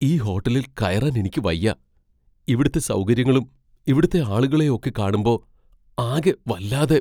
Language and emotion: Malayalam, fearful